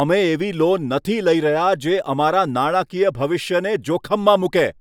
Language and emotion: Gujarati, angry